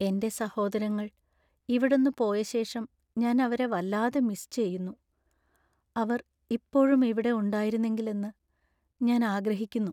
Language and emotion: Malayalam, sad